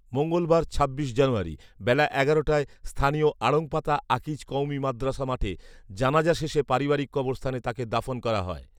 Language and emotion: Bengali, neutral